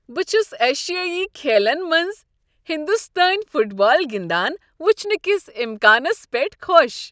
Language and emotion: Kashmiri, happy